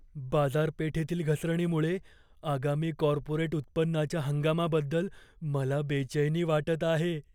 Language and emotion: Marathi, fearful